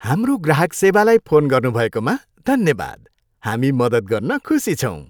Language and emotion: Nepali, happy